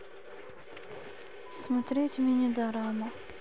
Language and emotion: Russian, sad